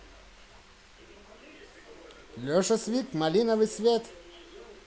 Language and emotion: Russian, positive